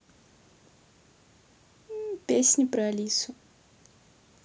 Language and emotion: Russian, neutral